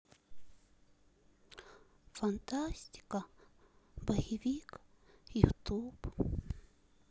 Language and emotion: Russian, sad